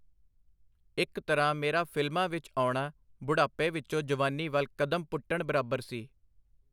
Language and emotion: Punjabi, neutral